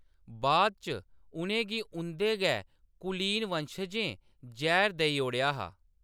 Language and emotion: Dogri, neutral